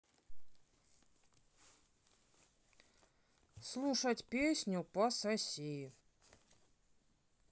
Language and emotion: Russian, neutral